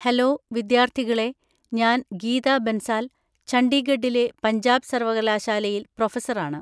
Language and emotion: Malayalam, neutral